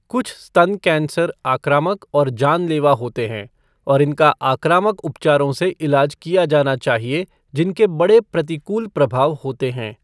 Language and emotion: Hindi, neutral